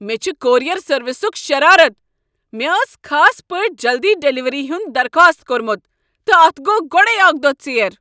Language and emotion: Kashmiri, angry